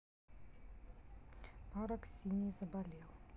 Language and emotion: Russian, neutral